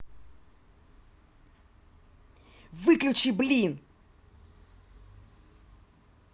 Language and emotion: Russian, angry